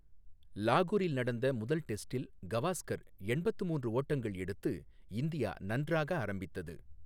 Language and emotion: Tamil, neutral